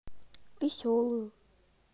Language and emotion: Russian, neutral